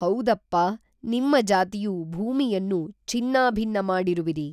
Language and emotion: Kannada, neutral